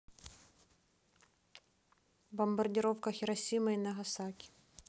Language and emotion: Russian, neutral